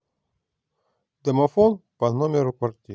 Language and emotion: Russian, neutral